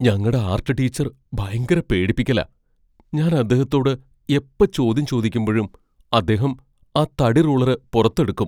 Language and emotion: Malayalam, fearful